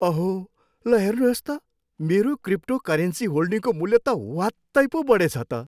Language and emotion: Nepali, happy